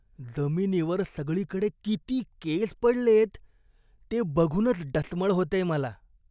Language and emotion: Marathi, disgusted